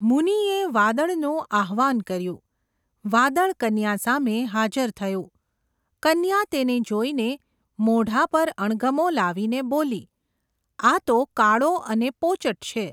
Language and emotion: Gujarati, neutral